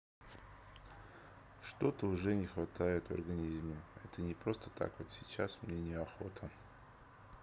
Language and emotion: Russian, sad